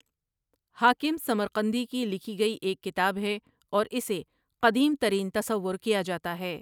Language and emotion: Urdu, neutral